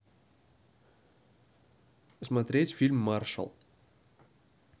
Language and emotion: Russian, neutral